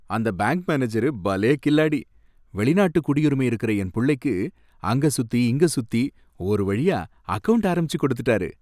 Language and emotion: Tamil, happy